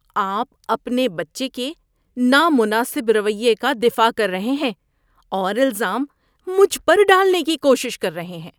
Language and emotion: Urdu, disgusted